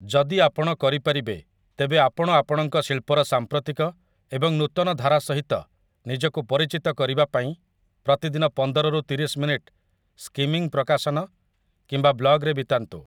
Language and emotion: Odia, neutral